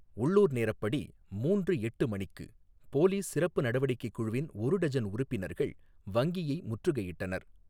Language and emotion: Tamil, neutral